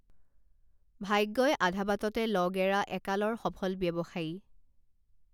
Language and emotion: Assamese, neutral